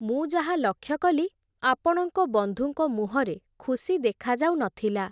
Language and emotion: Odia, neutral